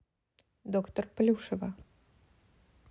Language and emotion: Russian, neutral